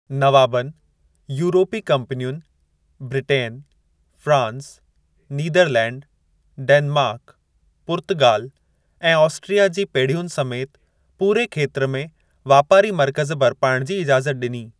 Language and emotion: Sindhi, neutral